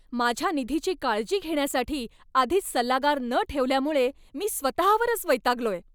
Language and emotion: Marathi, angry